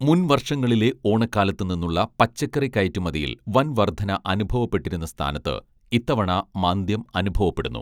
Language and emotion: Malayalam, neutral